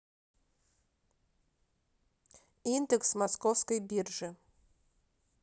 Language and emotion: Russian, neutral